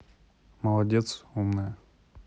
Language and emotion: Russian, neutral